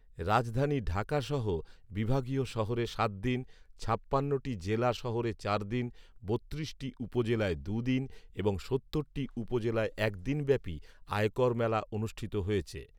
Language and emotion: Bengali, neutral